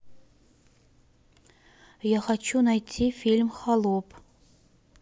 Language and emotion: Russian, neutral